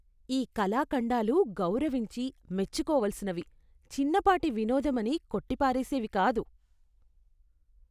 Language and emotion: Telugu, disgusted